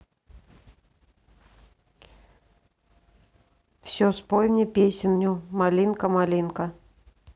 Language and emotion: Russian, neutral